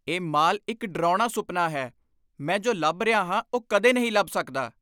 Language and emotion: Punjabi, angry